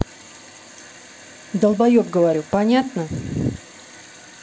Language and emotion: Russian, angry